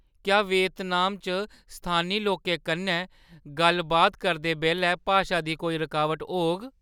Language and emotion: Dogri, fearful